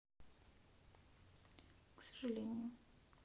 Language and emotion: Russian, sad